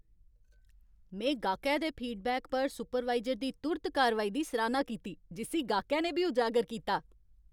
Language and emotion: Dogri, happy